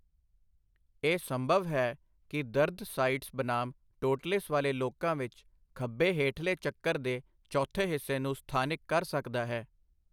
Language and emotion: Punjabi, neutral